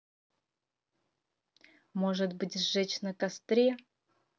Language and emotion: Russian, neutral